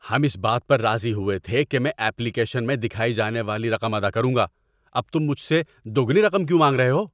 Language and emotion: Urdu, angry